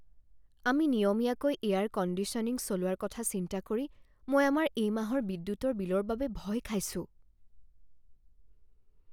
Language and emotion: Assamese, fearful